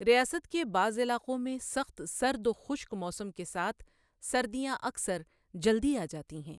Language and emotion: Urdu, neutral